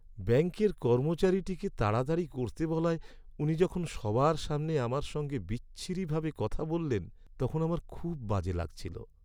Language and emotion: Bengali, sad